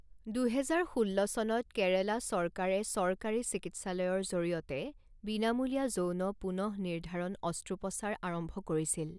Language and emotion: Assamese, neutral